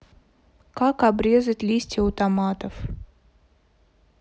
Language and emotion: Russian, sad